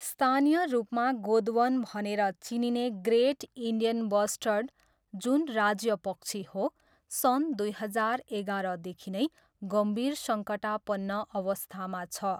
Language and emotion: Nepali, neutral